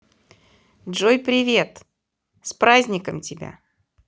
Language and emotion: Russian, positive